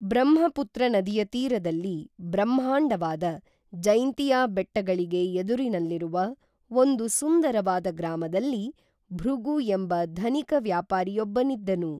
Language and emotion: Kannada, neutral